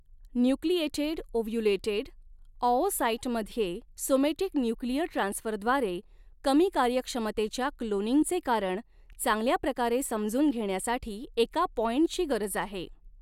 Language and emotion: Marathi, neutral